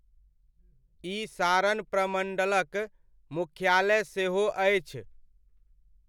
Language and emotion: Maithili, neutral